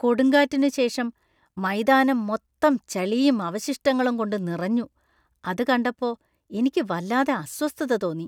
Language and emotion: Malayalam, disgusted